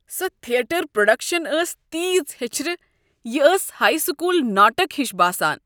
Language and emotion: Kashmiri, disgusted